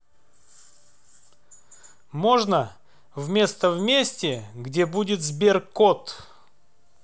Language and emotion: Russian, neutral